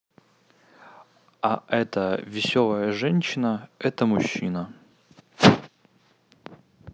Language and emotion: Russian, neutral